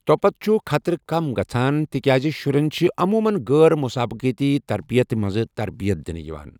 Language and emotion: Kashmiri, neutral